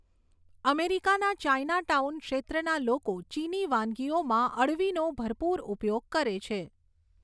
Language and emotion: Gujarati, neutral